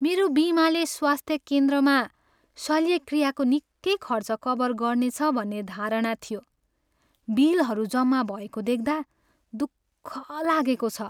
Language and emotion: Nepali, sad